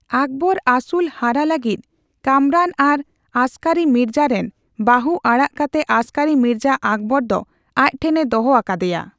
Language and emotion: Santali, neutral